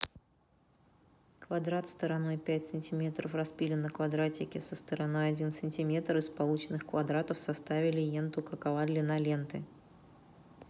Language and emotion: Russian, neutral